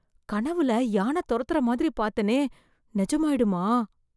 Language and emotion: Tamil, fearful